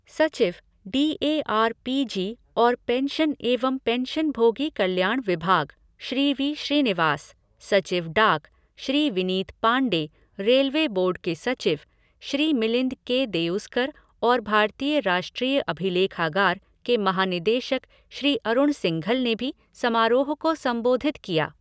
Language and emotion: Hindi, neutral